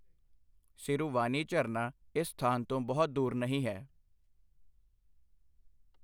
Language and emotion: Punjabi, neutral